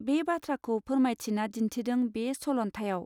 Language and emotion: Bodo, neutral